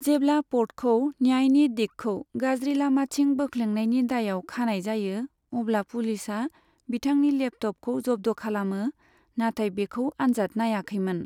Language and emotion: Bodo, neutral